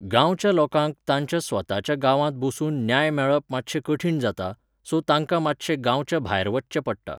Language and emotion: Goan Konkani, neutral